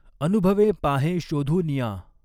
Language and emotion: Marathi, neutral